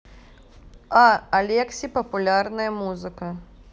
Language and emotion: Russian, neutral